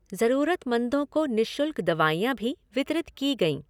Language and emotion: Hindi, neutral